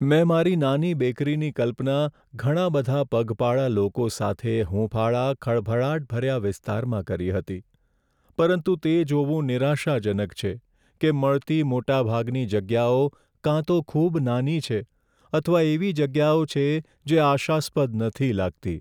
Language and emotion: Gujarati, sad